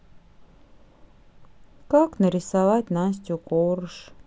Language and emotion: Russian, sad